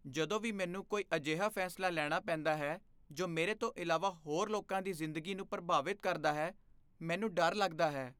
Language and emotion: Punjabi, fearful